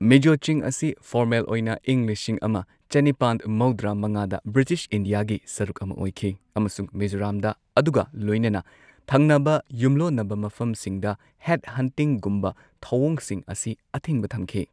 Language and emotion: Manipuri, neutral